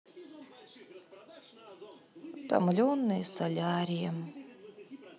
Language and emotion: Russian, sad